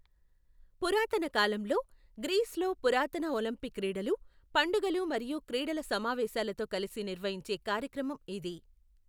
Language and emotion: Telugu, neutral